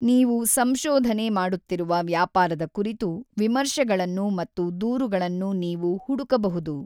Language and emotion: Kannada, neutral